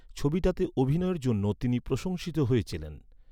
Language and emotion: Bengali, neutral